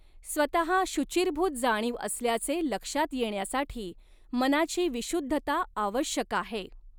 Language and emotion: Marathi, neutral